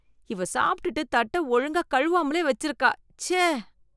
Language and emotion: Tamil, disgusted